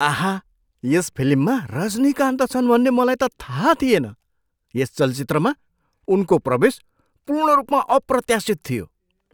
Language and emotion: Nepali, surprised